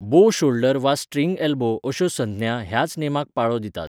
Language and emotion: Goan Konkani, neutral